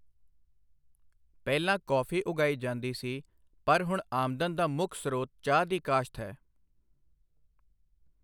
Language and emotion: Punjabi, neutral